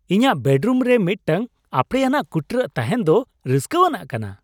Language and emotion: Santali, happy